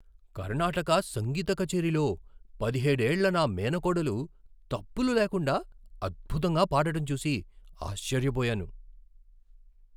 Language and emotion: Telugu, surprised